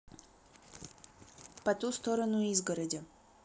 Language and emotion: Russian, neutral